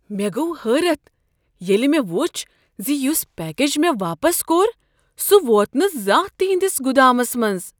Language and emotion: Kashmiri, surprised